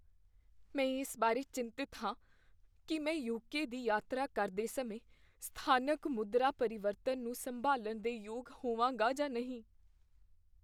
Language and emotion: Punjabi, fearful